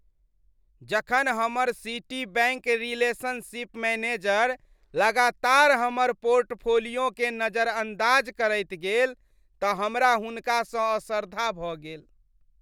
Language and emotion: Maithili, disgusted